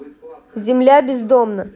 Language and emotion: Russian, neutral